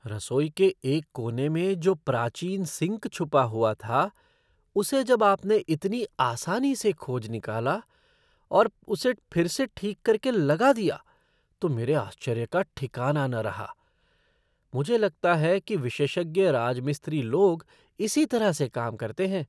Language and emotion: Hindi, surprised